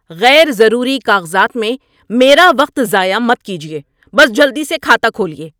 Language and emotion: Urdu, angry